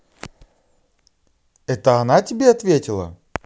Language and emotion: Russian, positive